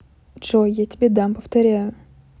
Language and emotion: Russian, neutral